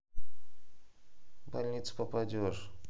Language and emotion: Russian, neutral